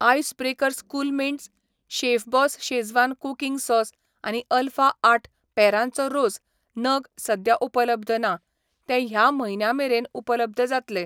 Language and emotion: Goan Konkani, neutral